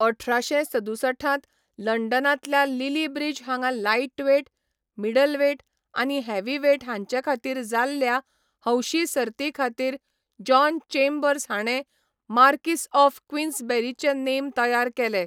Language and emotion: Goan Konkani, neutral